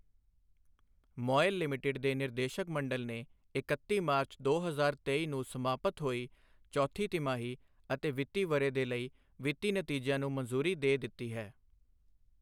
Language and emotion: Punjabi, neutral